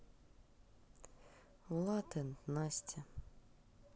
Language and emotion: Russian, neutral